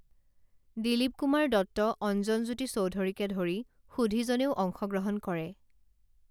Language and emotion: Assamese, neutral